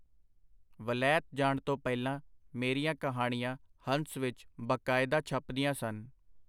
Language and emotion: Punjabi, neutral